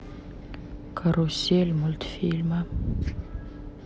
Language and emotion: Russian, neutral